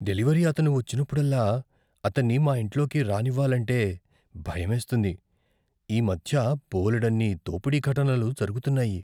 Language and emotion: Telugu, fearful